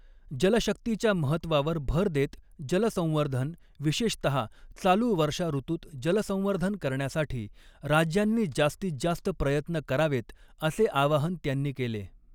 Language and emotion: Marathi, neutral